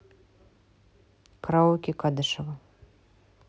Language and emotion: Russian, neutral